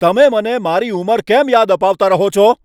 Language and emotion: Gujarati, angry